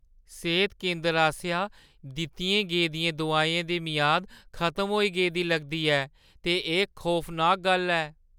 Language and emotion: Dogri, fearful